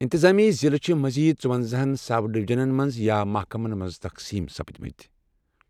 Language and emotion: Kashmiri, neutral